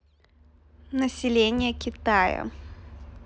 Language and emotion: Russian, neutral